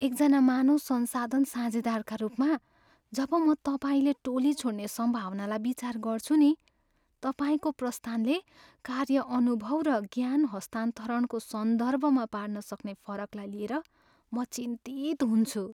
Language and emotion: Nepali, fearful